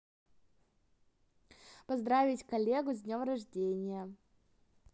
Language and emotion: Russian, positive